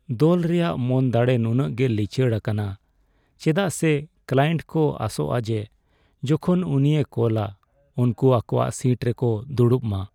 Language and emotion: Santali, sad